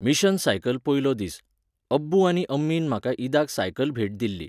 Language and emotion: Goan Konkani, neutral